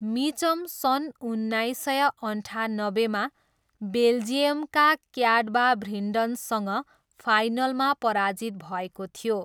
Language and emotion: Nepali, neutral